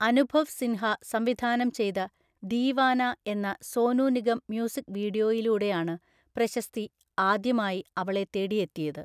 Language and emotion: Malayalam, neutral